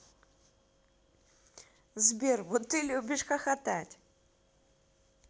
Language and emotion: Russian, positive